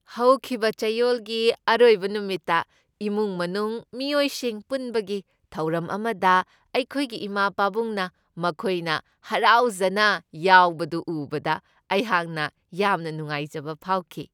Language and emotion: Manipuri, happy